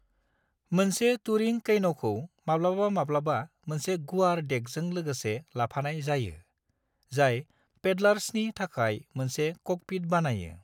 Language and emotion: Bodo, neutral